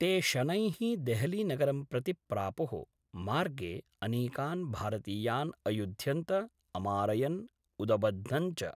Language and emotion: Sanskrit, neutral